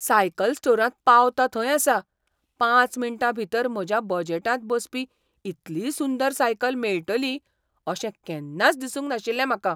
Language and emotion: Goan Konkani, surprised